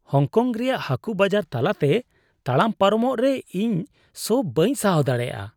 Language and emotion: Santali, disgusted